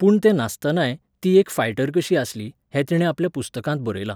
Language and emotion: Goan Konkani, neutral